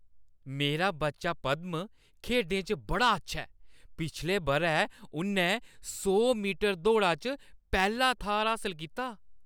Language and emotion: Dogri, happy